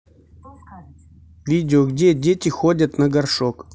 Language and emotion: Russian, neutral